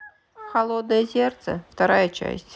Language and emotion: Russian, neutral